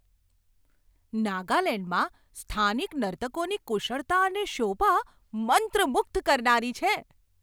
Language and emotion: Gujarati, surprised